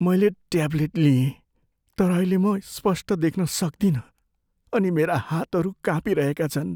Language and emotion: Nepali, fearful